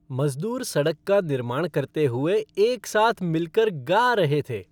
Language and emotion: Hindi, happy